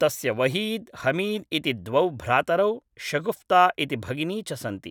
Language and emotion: Sanskrit, neutral